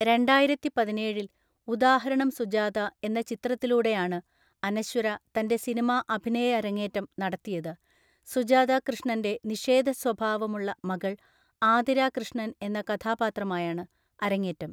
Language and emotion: Malayalam, neutral